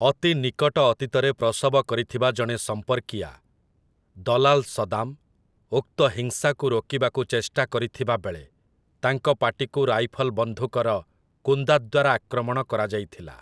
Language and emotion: Odia, neutral